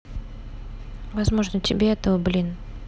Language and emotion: Russian, neutral